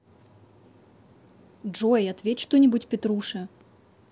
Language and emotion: Russian, neutral